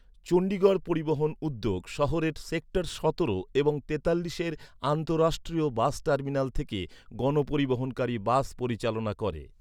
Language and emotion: Bengali, neutral